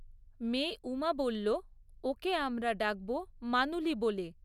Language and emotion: Bengali, neutral